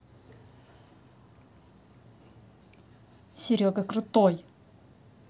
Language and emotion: Russian, positive